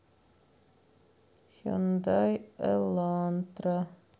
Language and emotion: Russian, sad